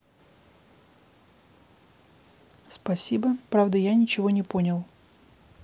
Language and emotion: Russian, neutral